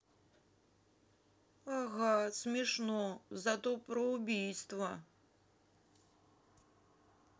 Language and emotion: Russian, sad